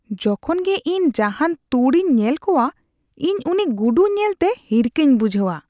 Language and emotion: Santali, disgusted